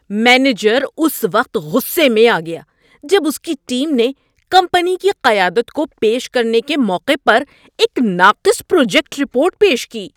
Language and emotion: Urdu, angry